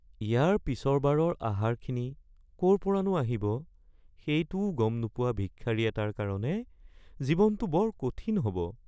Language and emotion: Assamese, sad